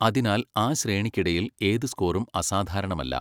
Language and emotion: Malayalam, neutral